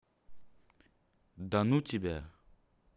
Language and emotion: Russian, neutral